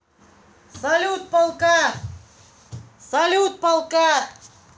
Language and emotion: Russian, positive